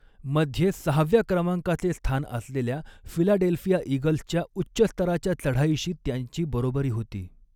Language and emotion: Marathi, neutral